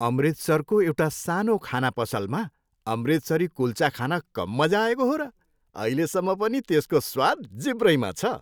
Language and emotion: Nepali, happy